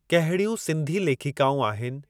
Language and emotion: Sindhi, neutral